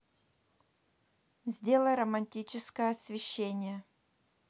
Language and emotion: Russian, neutral